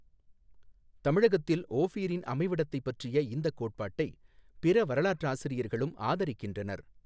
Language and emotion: Tamil, neutral